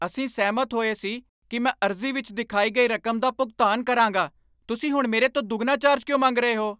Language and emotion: Punjabi, angry